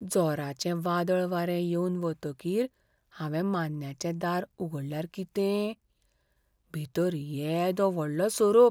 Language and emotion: Goan Konkani, fearful